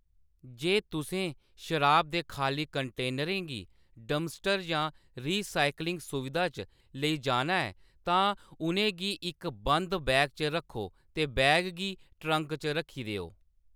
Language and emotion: Dogri, neutral